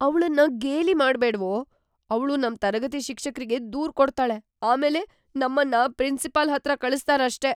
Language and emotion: Kannada, fearful